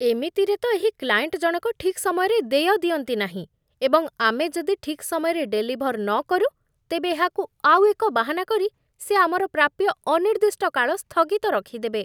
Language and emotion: Odia, disgusted